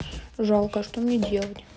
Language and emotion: Russian, neutral